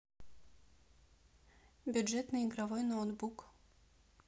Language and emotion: Russian, neutral